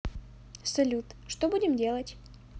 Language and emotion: Russian, neutral